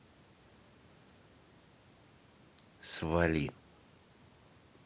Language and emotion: Russian, angry